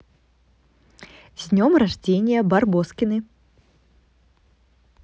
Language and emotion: Russian, positive